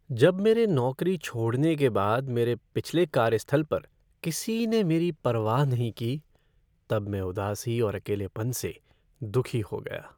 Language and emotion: Hindi, sad